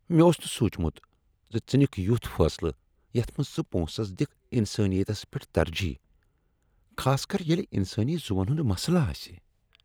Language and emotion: Kashmiri, disgusted